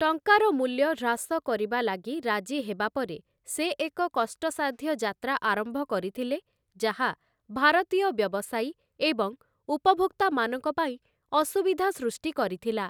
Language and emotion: Odia, neutral